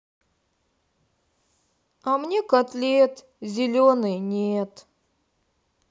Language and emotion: Russian, sad